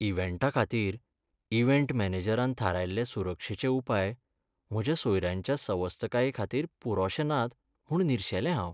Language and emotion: Goan Konkani, sad